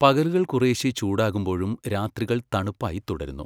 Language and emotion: Malayalam, neutral